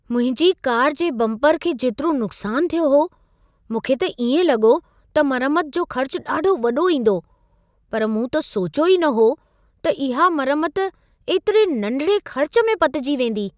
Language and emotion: Sindhi, surprised